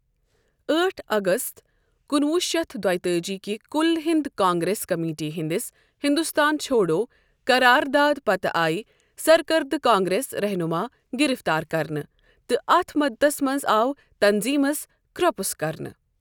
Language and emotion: Kashmiri, neutral